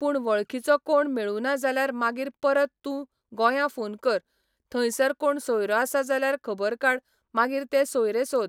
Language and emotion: Goan Konkani, neutral